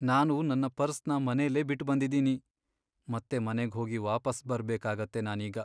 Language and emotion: Kannada, sad